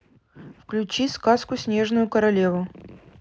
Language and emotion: Russian, neutral